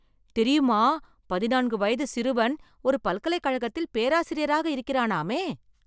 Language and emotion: Tamil, surprised